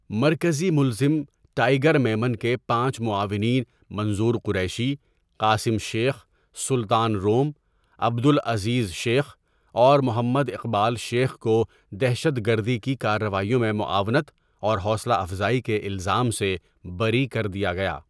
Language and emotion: Urdu, neutral